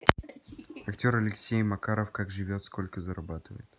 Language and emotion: Russian, neutral